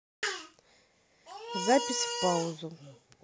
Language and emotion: Russian, neutral